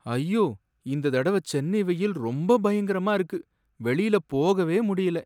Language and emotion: Tamil, sad